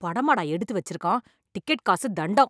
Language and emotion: Tamil, angry